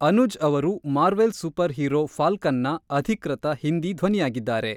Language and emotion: Kannada, neutral